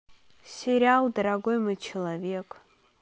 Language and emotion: Russian, neutral